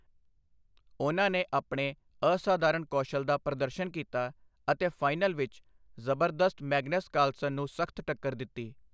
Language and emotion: Punjabi, neutral